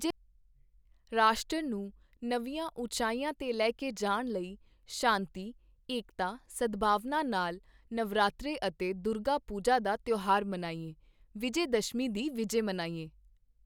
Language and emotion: Punjabi, neutral